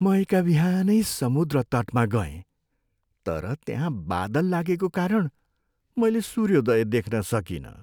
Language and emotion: Nepali, sad